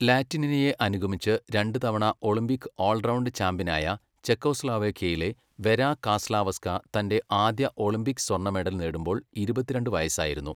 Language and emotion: Malayalam, neutral